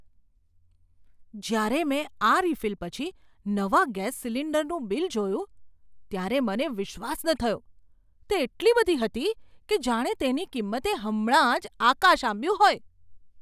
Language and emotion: Gujarati, surprised